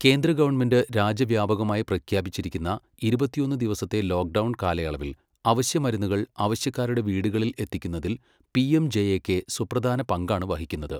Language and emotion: Malayalam, neutral